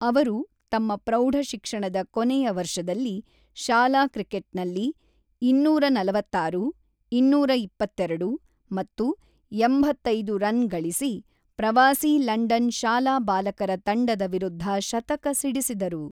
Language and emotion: Kannada, neutral